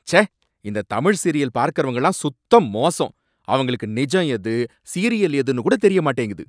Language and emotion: Tamil, angry